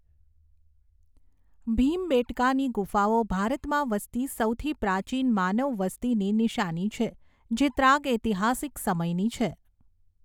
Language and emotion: Gujarati, neutral